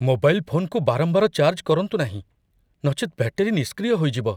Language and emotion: Odia, fearful